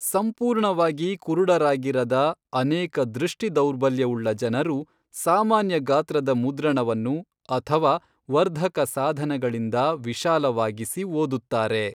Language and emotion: Kannada, neutral